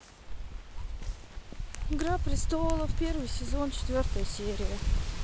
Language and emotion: Russian, neutral